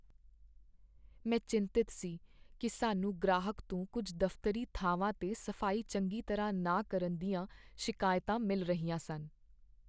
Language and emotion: Punjabi, sad